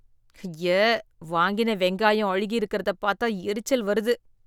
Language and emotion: Tamil, disgusted